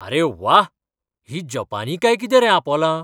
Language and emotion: Goan Konkani, surprised